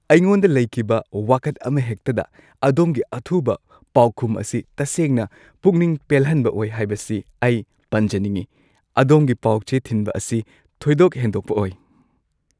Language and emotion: Manipuri, happy